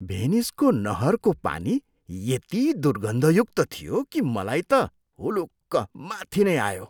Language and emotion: Nepali, disgusted